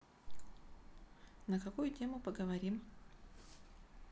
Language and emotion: Russian, neutral